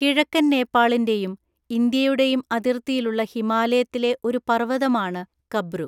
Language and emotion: Malayalam, neutral